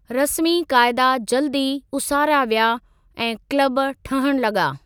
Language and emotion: Sindhi, neutral